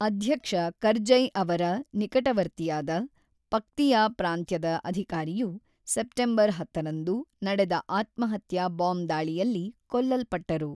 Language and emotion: Kannada, neutral